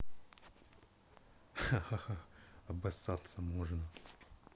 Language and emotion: Russian, angry